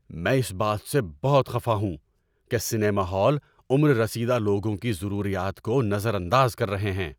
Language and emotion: Urdu, angry